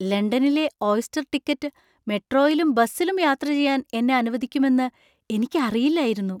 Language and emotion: Malayalam, surprised